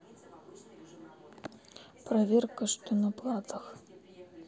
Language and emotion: Russian, sad